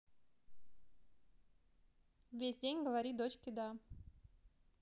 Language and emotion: Russian, neutral